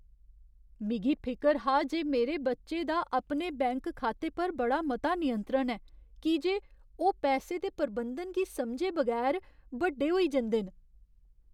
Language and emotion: Dogri, fearful